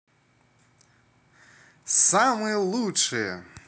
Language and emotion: Russian, positive